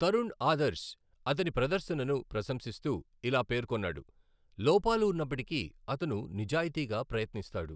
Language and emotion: Telugu, neutral